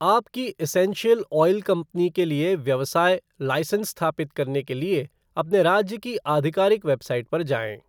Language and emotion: Hindi, neutral